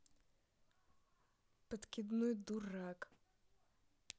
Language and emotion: Russian, angry